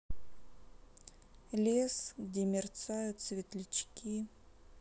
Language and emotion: Russian, sad